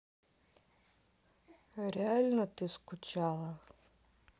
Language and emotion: Russian, sad